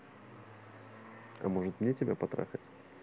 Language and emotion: Russian, neutral